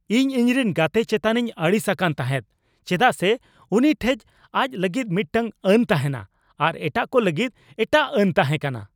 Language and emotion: Santali, angry